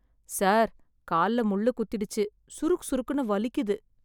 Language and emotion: Tamil, sad